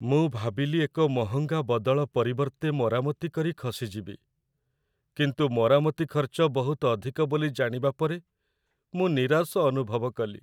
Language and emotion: Odia, sad